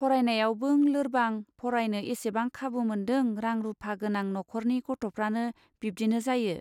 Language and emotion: Bodo, neutral